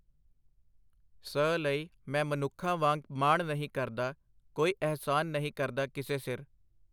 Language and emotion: Punjabi, neutral